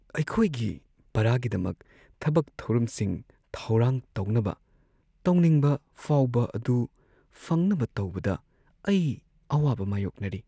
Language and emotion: Manipuri, sad